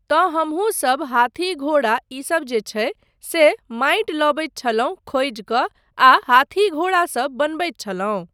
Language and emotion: Maithili, neutral